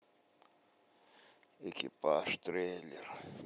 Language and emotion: Russian, sad